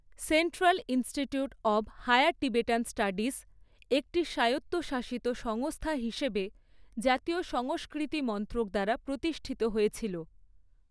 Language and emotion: Bengali, neutral